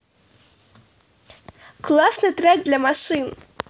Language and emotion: Russian, positive